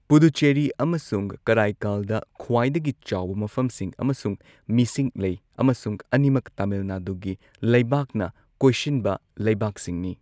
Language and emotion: Manipuri, neutral